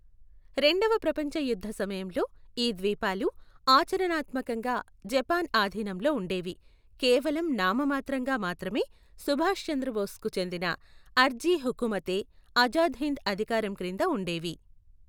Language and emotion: Telugu, neutral